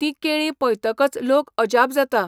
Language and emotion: Goan Konkani, neutral